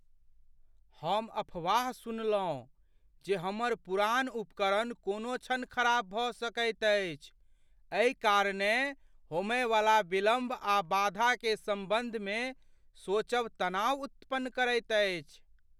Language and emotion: Maithili, fearful